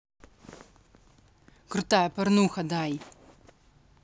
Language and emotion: Russian, angry